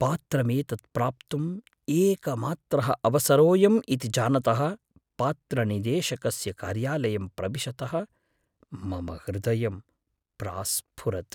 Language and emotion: Sanskrit, fearful